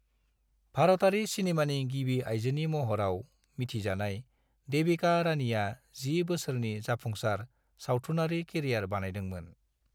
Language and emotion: Bodo, neutral